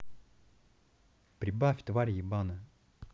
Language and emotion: Russian, angry